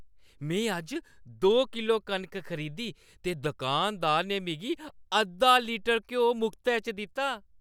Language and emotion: Dogri, happy